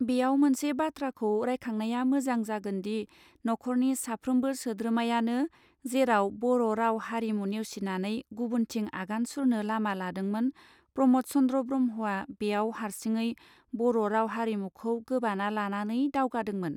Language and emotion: Bodo, neutral